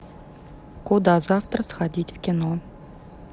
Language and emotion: Russian, neutral